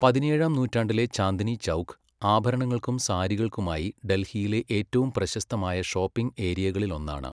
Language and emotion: Malayalam, neutral